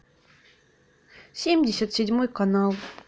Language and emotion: Russian, sad